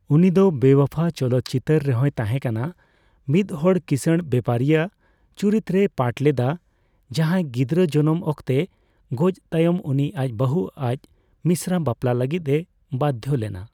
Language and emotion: Santali, neutral